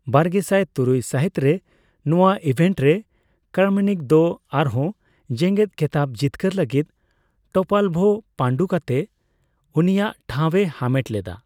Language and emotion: Santali, neutral